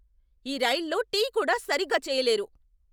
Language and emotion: Telugu, angry